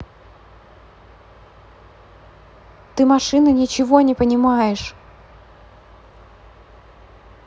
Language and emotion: Russian, angry